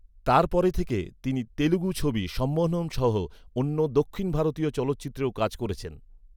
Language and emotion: Bengali, neutral